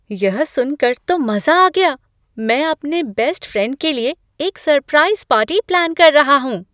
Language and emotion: Hindi, surprised